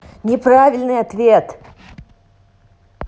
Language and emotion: Russian, angry